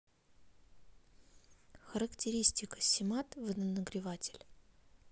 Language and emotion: Russian, neutral